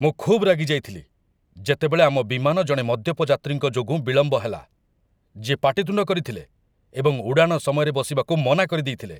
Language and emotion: Odia, angry